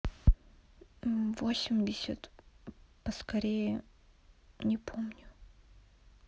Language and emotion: Russian, sad